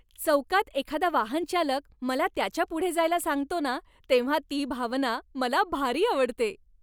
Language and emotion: Marathi, happy